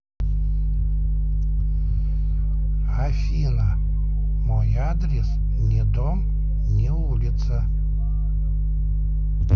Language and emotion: Russian, neutral